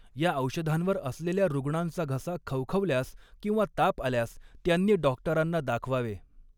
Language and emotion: Marathi, neutral